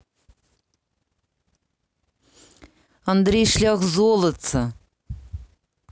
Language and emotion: Russian, neutral